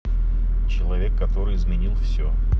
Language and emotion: Russian, neutral